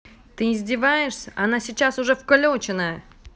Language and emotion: Russian, angry